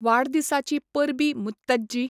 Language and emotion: Goan Konkani, neutral